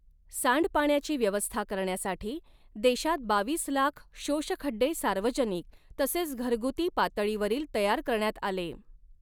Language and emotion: Marathi, neutral